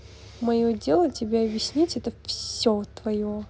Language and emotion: Russian, neutral